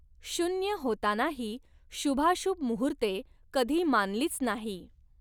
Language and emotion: Marathi, neutral